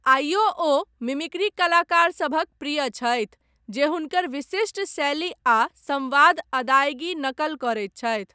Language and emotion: Maithili, neutral